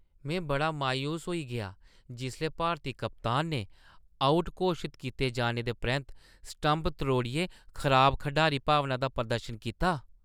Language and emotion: Dogri, disgusted